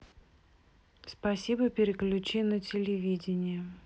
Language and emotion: Russian, neutral